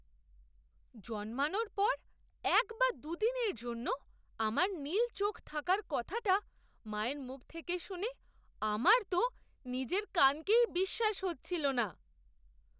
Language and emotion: Bengali, surprised